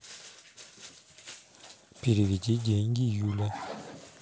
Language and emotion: Russian, neutral